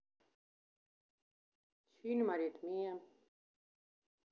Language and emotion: Russian, neutral